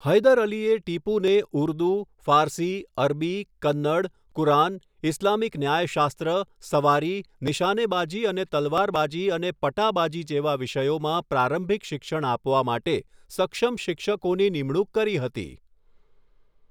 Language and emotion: Gujarati, neutral